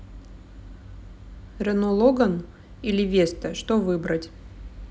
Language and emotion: Russian, neutral